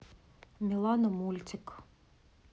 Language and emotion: Russian, neutral